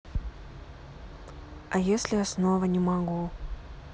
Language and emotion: Russian, sad